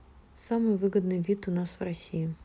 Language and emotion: Russian, neutral